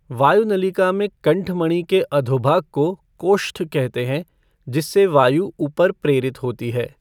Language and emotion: Hindi, neutral